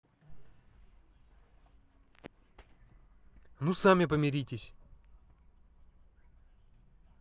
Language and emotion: Russian, angry